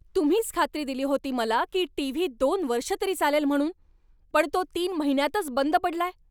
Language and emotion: Marathi, angry